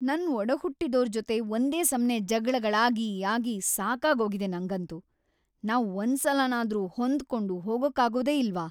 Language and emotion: Kannada, angry